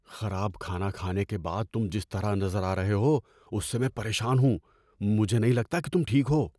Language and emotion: Urdu, fearful